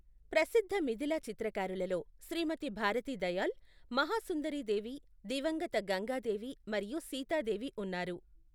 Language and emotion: Telugu, neutral